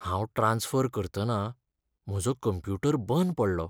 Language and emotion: Goan Konkani, sad